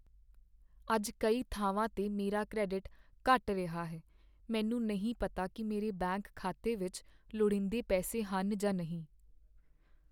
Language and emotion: Punjabi, sad